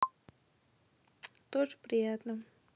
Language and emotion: Russian, neutral